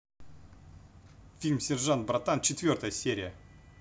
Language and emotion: Russian, positive